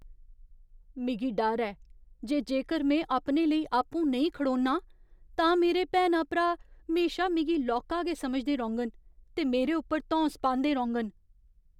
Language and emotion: Dogri, fearful